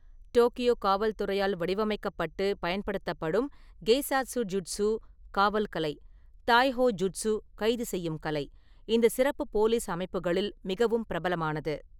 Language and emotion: Tamil, neutral